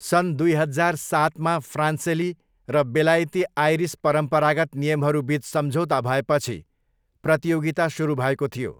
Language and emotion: Nepali, neutral